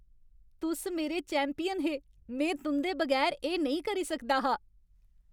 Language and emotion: Dogri, happy